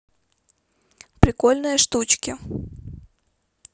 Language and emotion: Russian, neutral